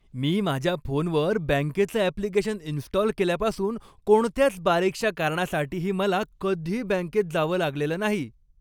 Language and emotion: Marathi, happy